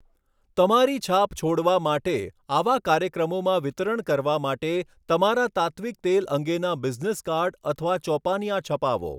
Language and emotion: Gujarati, neutral